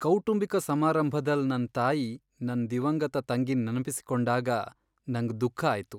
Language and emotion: Kannada, sad